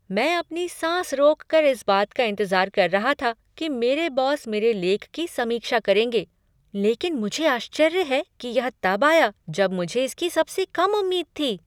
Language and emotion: Hindi, surprised